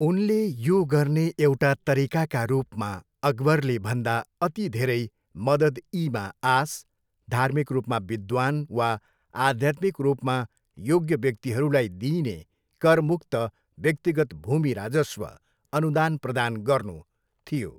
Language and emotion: Nepali, neutral